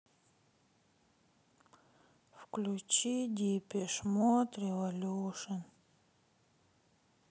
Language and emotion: Russian, sad